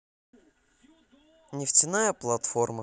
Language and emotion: Russian, neutral